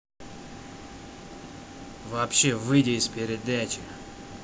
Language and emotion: Russian, angry